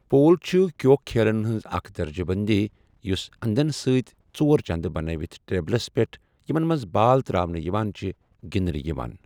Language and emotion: Kashmiri, neutral